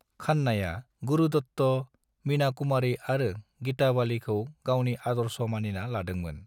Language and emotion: Bodo, neutral